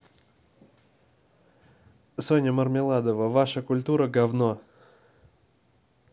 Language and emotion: Russian, neutral